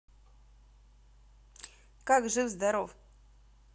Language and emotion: Russian, positive